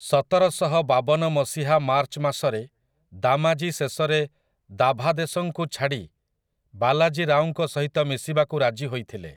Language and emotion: Odia, neutral